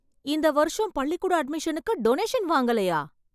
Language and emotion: Tamil, surprised